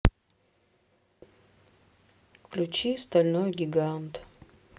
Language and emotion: Russian, sad